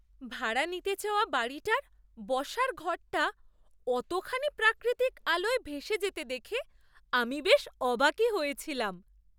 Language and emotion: Bengali, surprised